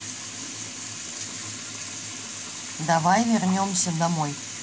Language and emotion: Russian, neutral